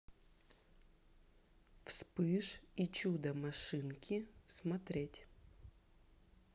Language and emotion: Russian, neutral